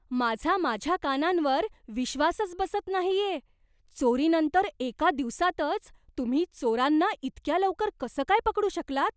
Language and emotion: Marathi, surprised